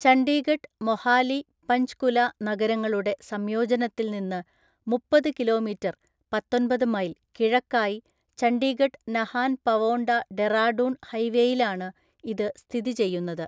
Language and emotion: Malayalam, neutral